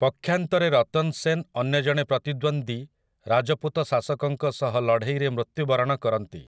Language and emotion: Odia, neutral